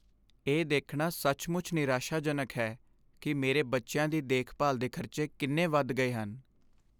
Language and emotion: Punjabi, sad